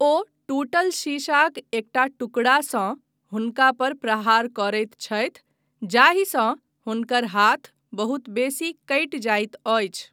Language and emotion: Maithili, neutral